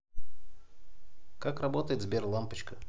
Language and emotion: Russian, neutral